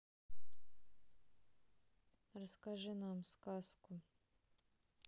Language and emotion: Russian, sad